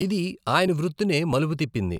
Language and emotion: Telugu, neutral